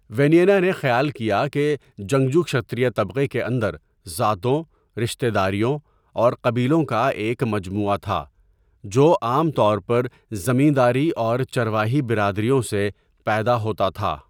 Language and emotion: Urdu, neutral